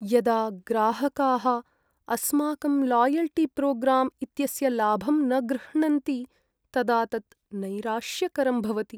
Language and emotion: Sanskrit, sad